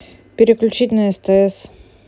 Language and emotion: Russian, neutral